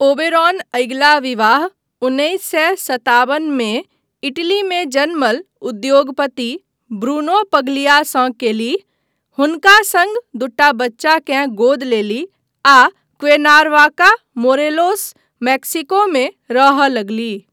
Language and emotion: Maithili, neutral